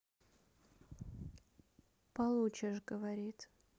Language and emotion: Russian, neutral